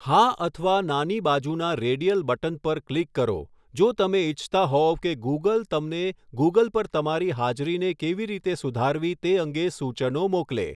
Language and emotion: Gujarati, neutral